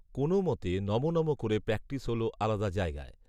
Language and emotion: Bengali, neutral